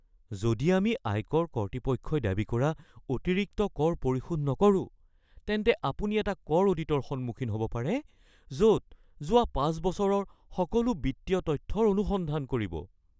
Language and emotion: Assamese, fearful